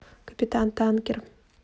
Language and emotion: Russian, neutral